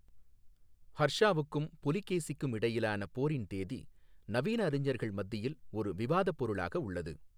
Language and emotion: Tamil, neutral